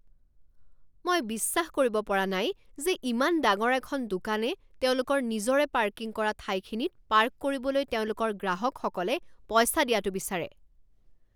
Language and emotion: Assamese, angry